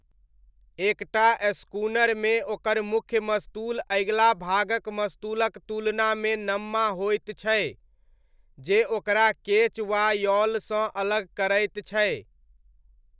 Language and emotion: Maithili, neutral